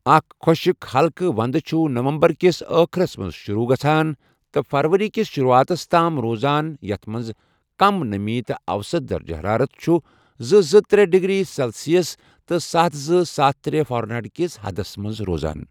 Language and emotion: Kashmiri, neutral